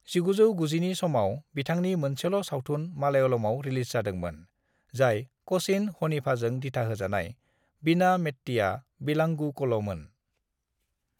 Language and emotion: Bodo, neutral